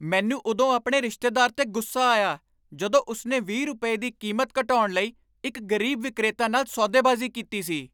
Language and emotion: Punjabi, angry